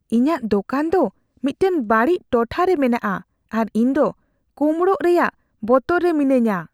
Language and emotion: Santali, fearful